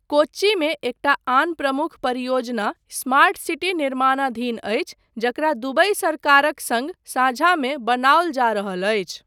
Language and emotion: Maithili, neutral